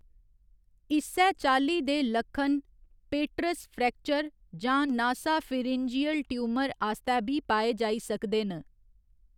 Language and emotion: Dogri, neutral